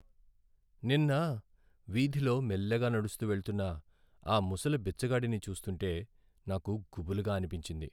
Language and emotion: Telugu, sad